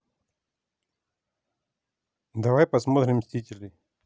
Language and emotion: Russian, neutral